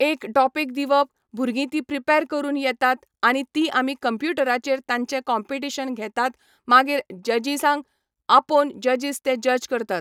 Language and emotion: Goan Konkani, neutral